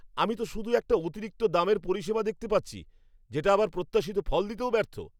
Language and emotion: Bengali, angry